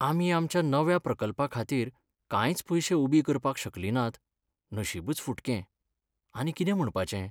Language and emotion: Goan Konkani, sad